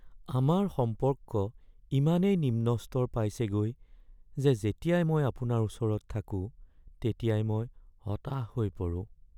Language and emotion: Assamese, sad